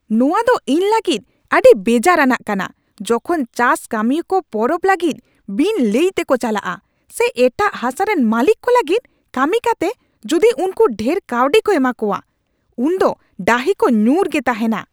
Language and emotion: Santali, angry